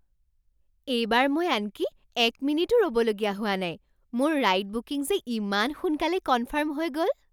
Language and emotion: Assamese, surprised